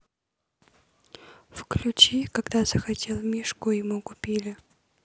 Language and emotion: Russian, neutral